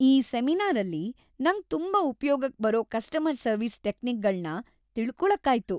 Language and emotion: Kannada, happy